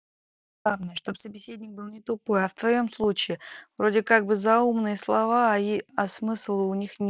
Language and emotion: Russian, neutral